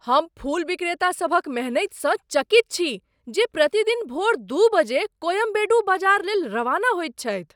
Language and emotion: Maithili, surprised